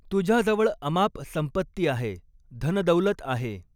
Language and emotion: Marathi, neutral